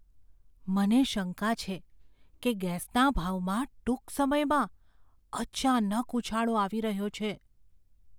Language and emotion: Gujarati, fearful